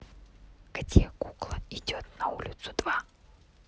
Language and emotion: Russian, neutral